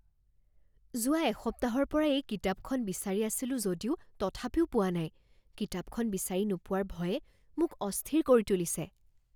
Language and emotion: Assamese, fearful